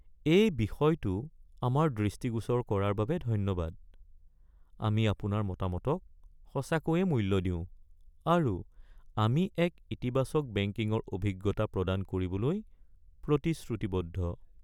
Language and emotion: Assamese, sad